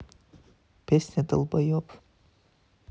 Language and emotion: Russian, neutral